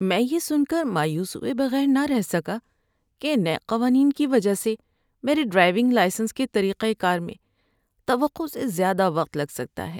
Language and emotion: Urdu, sad